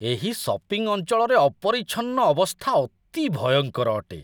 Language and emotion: Odia, disgusted